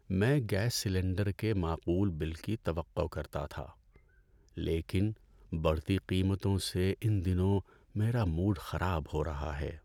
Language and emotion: Urdu, sad